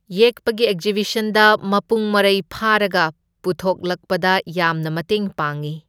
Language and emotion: Manipuri, neutral